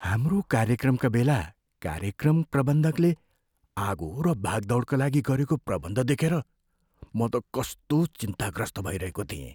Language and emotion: Nepali, fearful